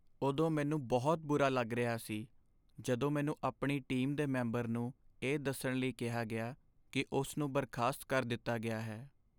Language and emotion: Punjabi, sad